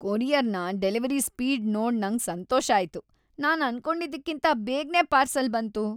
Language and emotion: Kannada, happy